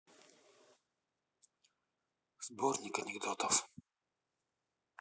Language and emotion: Russian, neutral